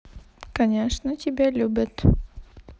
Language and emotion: Russian, neutral